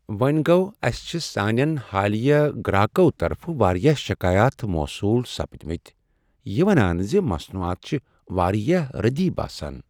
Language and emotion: Kashmiri, sad